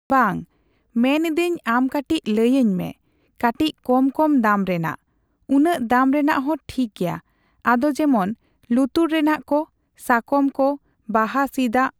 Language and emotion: Santali, neutral